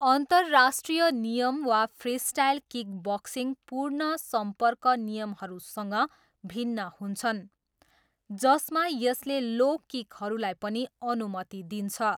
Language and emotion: Nepali, neutral